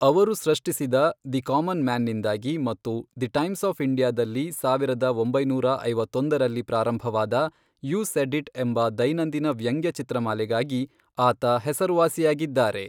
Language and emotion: Kannada, neutral